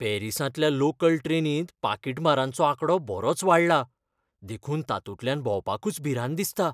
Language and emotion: Goan Konkani, fearful